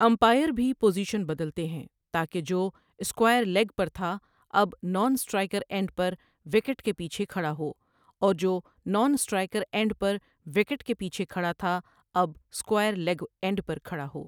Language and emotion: Urdu, neutral